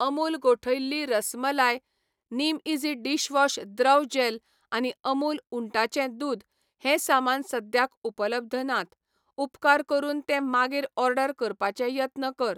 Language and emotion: Goan Konkani, neutral